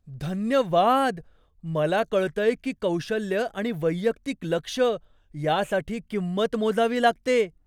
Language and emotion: Marathi, surprised